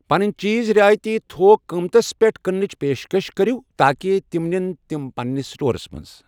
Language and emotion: Kashmiri, neutral